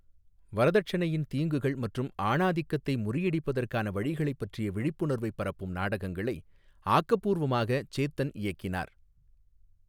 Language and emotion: Tamil, neutral